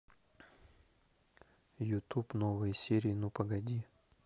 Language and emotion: Russian, neutral